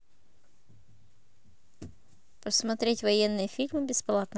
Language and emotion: Russian, neutral